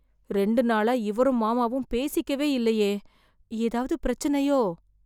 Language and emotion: Tamil, fearful